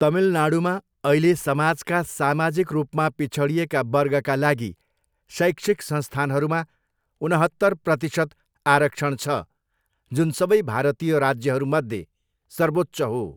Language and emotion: Nepali, neutral